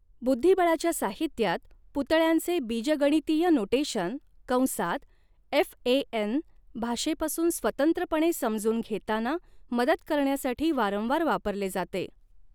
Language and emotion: Marathi, neutral